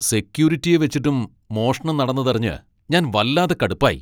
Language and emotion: Malayalam, angry